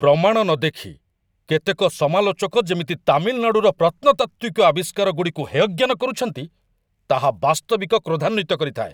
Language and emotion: Odia, angry